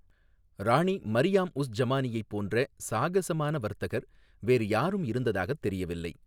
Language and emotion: Tamil, neutral